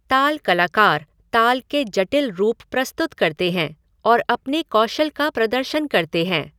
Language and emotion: Hindi, neutral